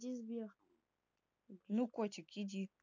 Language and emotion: Russian, neutral